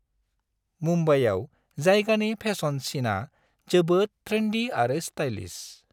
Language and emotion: Bodo, happy